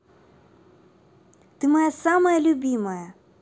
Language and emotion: Russian, positive